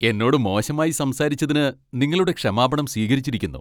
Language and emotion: Malayalam, happy